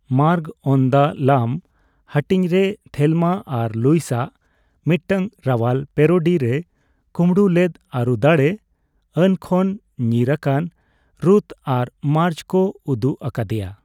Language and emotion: Santali, neutral